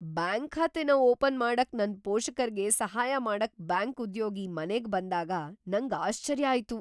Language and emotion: Kannada, surprised